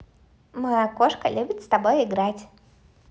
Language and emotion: Russian, positive